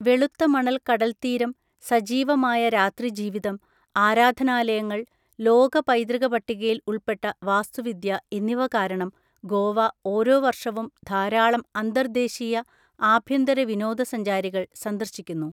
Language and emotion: Malayalam, neutral